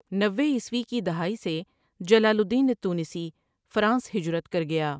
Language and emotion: Urdu, neutral